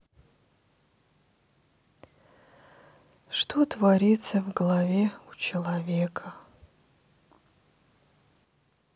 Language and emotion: Russian, sad